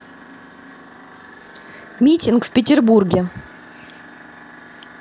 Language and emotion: Russian, angry